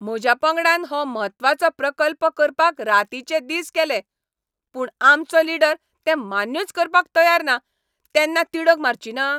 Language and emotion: Goan Konkani, angry